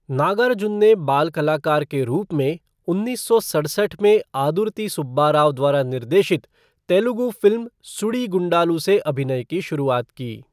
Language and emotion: Hindi, neutral